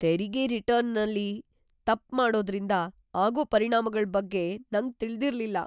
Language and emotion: Kannada, fearful